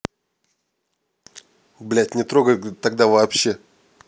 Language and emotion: Russian, angry